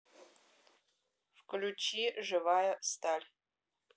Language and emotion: Russian, neutral